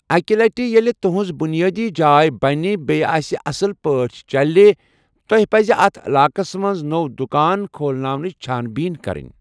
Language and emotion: Kashmiri, neutral